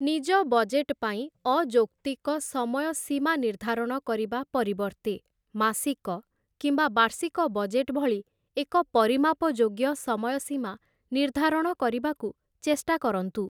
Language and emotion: Odia, neutral